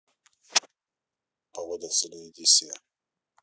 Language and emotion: Russian, neutral